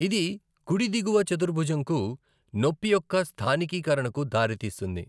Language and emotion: Telugu, neutral